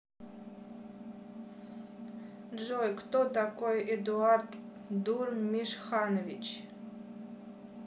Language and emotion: Russian, neutral